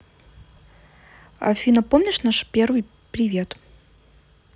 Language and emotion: Russian, neutral